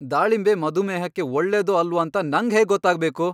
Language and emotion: Kannada, angry